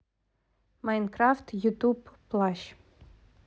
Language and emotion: Russian, neutral